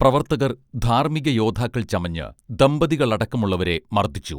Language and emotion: Malayalam, neutral